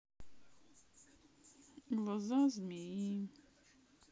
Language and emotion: Russian, sad